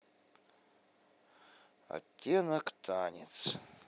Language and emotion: Russian, sad